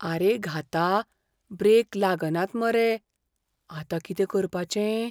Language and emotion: Goan Konkani, fearful